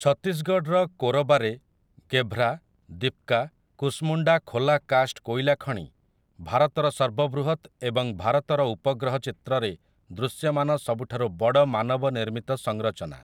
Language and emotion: Odia, neutral